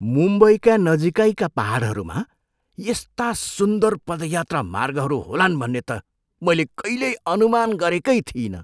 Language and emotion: Nepali, surprised